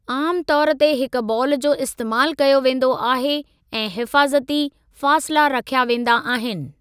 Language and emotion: Sindhi, neutral